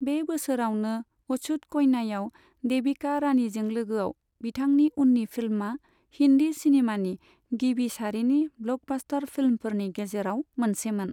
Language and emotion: Bodo, neutral